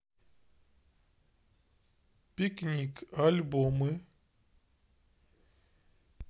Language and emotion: Russian, neutral